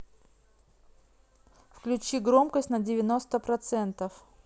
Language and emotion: Russian, neutral